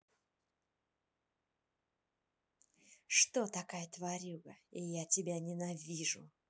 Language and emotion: Russian, angry